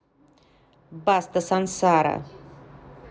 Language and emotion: Russian, neutral